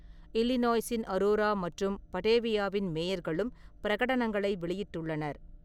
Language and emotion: Tamil, neutral